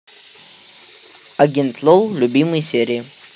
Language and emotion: Russian, neutral